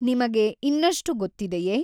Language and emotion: Kannada, neutral